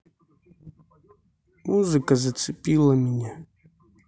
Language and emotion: Russian, neutral